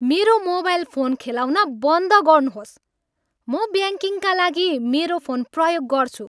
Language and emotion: Nepali, angry